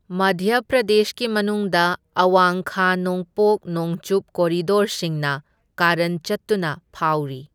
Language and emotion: Manipuri, neutral